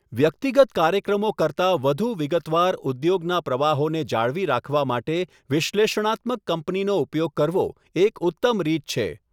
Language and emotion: Gujarati, neutral